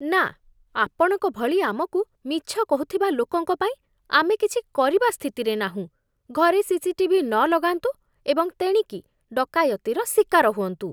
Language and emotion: Odia, disgusted